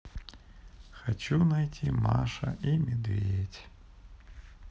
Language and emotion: Russian, sad